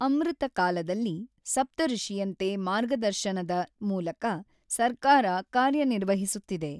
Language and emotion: Kannada, neutral